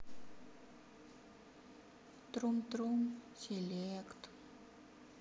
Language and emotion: Russian, sad